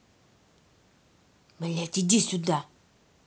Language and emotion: Russian, angry